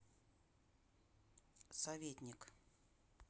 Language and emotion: Russian, neutral